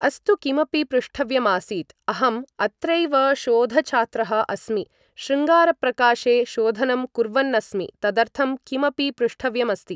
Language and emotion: Sanskrit, neutral